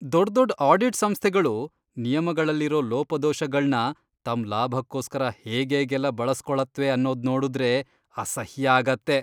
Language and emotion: Kannada, disgusted